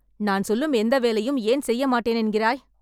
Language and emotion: Tamil, angry